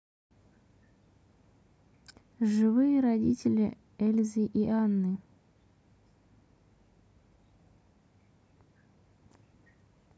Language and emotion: Russian, neutral